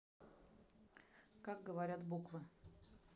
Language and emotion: Russian, neutral